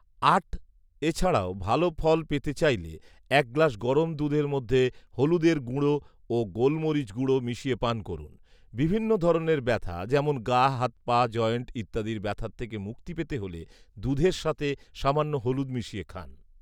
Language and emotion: Bengali, neutral